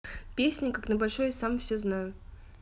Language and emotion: Russian, neutral